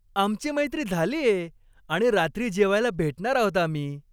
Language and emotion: Marathi, happy